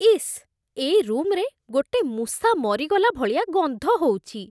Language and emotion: Odia, disgusted